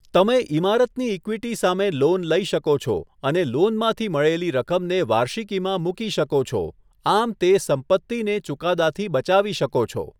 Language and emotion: Gujarati, neutral